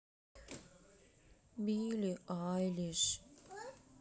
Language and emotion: Russian, sad